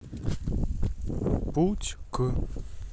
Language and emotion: Russian, neutral